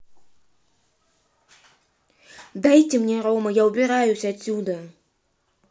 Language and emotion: Russian, angry